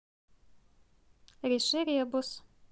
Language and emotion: Russian, neutral